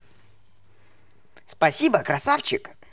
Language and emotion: Russian, positive